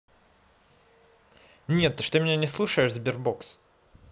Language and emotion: Russian, angry